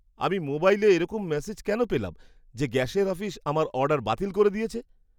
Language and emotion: Bengali, surprised